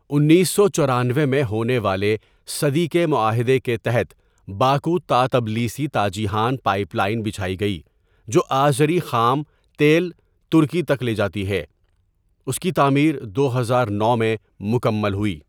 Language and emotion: Urdu, neutral